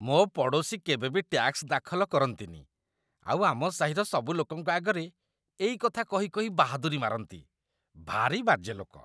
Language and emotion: Odia, disgusted